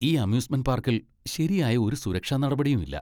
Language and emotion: Malayalam, disgusted